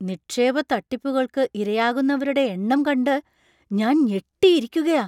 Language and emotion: Malayalam, surprised